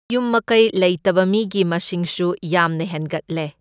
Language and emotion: Manipuri, neutral